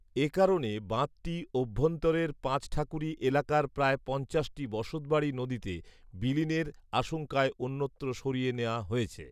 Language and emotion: Bengali, neutral